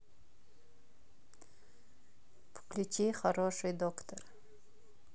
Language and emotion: Russian, neutral